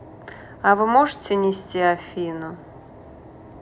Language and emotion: Russian, neutral